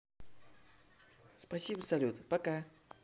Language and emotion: Russian, positive